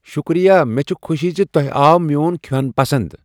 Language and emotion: Kashmiri, surprised